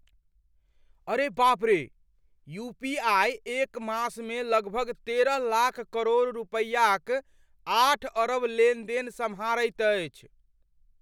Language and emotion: Maithili, surprised